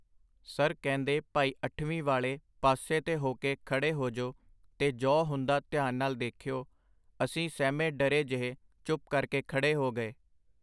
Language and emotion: Punjabi, neutral